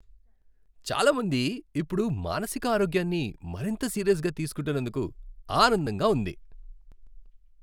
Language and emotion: Telugu, happy